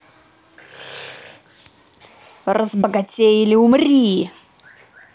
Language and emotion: Russian, angry